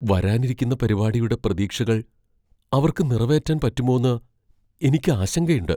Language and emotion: Malayalam, fearful